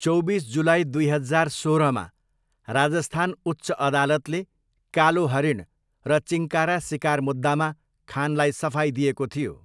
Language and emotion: Nepali, neutral